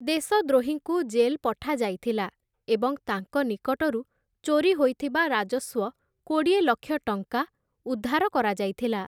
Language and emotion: Odia, neutral